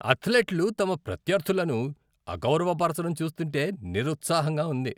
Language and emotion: Telugu, disgusted